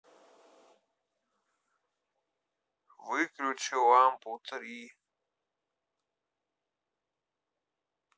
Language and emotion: Russian, sad